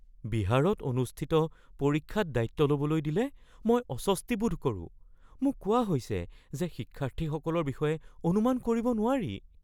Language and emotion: Assamese, fearful